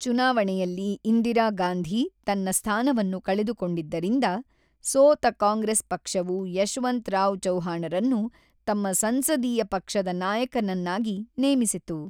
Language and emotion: Kannada, neutral